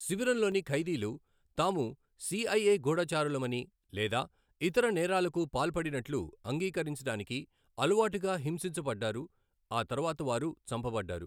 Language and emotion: Telugu, neutral